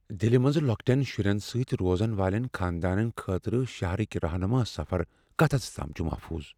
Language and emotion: Kashmiri, fearful